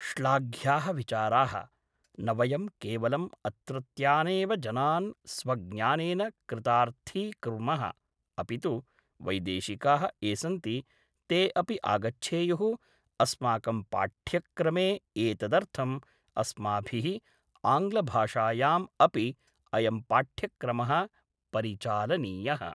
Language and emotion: Sanskrit, neutral